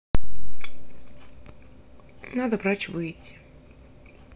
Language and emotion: Russian, sad